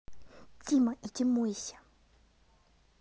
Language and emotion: Russian, neutral